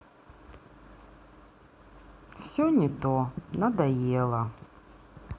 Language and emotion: Russian, sad